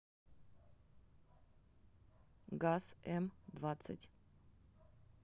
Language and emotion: Russian, neutral